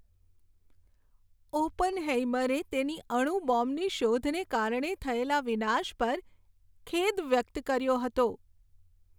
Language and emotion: Gujarati, sad